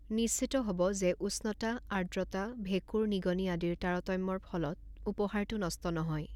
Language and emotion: Assamese, neutral